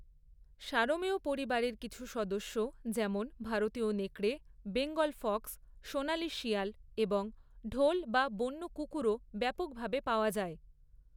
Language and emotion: Bengali, neutral